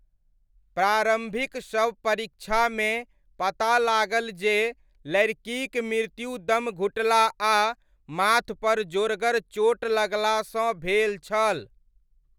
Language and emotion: Maithili, neutral